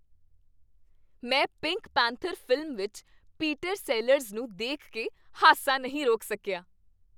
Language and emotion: Punjabi, happy